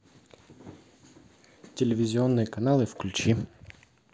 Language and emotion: Russian, neutral